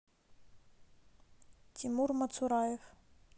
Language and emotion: Russian, neutral